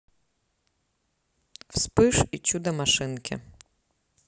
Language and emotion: Russian, neutral